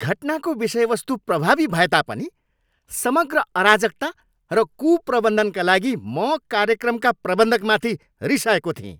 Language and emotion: Nepali, angry